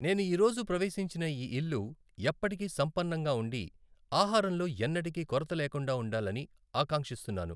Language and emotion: Telugu, neutral